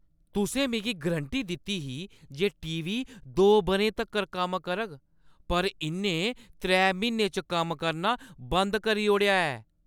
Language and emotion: Dogri, angry